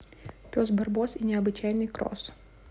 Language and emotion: Russian, neutral